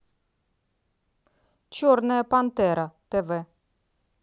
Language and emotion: Russian, neutral